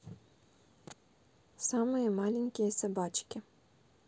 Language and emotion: Russian, neutral